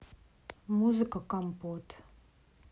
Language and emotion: Russian, neutral